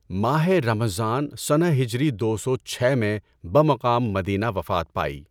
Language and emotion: Urdu, neutral